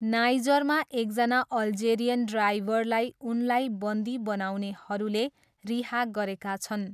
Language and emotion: Nepali, neutral